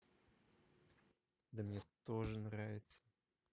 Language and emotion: Russian, neutral